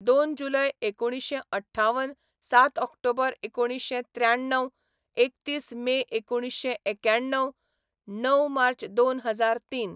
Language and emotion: Goan Konkani, neutral